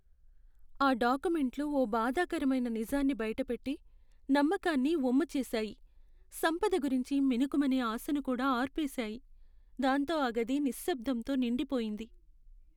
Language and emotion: Telugu, sad